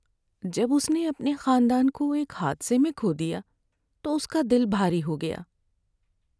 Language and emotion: Urdu, sad